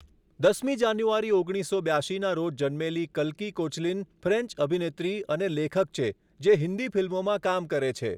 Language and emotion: Gujarati, neutral